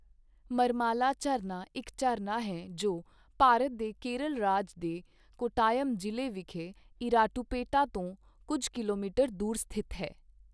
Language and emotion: Punjabi, neutral